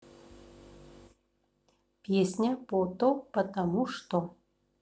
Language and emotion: Russian, neutral